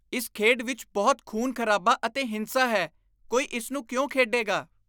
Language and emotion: Punjabi, disgusted